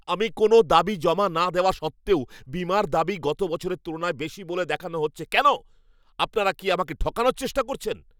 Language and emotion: Bengali, angry